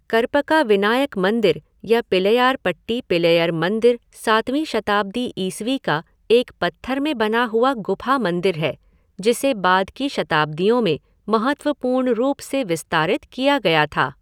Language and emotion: Hindi, neutral